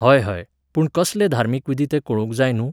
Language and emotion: Goan Konkani, neutral